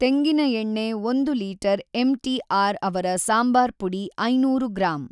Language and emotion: Kannada, neutral